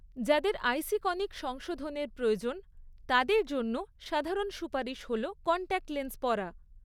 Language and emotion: Bengali, neutral